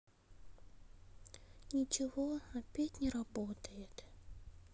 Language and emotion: Russian, sad